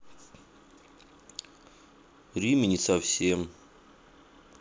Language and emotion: Russian, sad